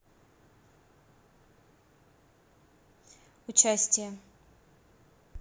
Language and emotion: Russian, neutral